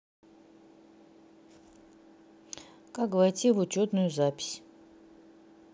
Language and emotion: Russian, neutral